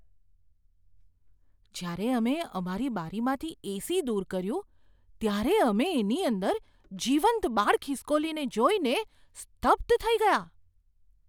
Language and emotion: Gujarati, surprised